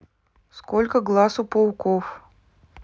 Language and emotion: Russian, neutral